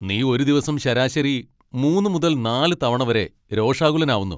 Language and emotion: Malayalam, angry